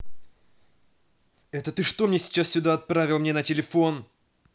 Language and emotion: Russian, angry